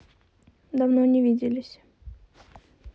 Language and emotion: Russian, neutral